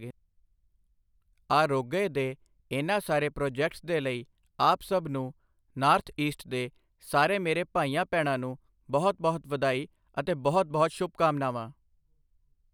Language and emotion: Punjabi, neutral